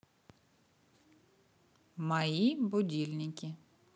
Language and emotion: Russian, neutral